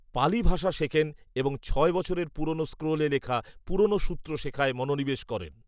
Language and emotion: Bengali, neutral